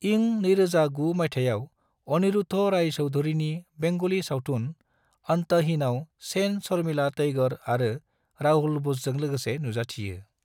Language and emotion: Bodo, neutral